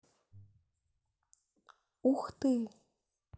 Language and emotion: Russian, neutral